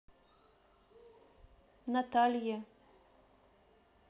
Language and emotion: Russian, neutral